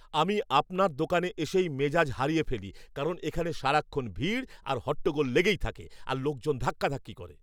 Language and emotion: Bengali, angry